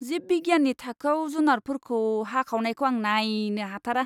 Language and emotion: Bodo, disgusted